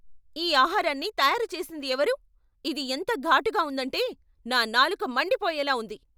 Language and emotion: Telugu, angry